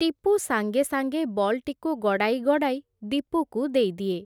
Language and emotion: Odia, neutral